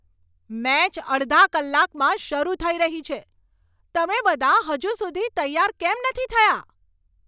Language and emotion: Gujarati, angry